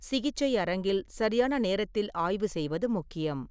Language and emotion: Tamil, neutral